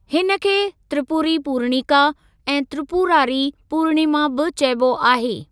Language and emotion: Sindhi, neutral